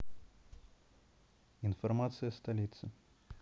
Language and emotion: Russian, neutral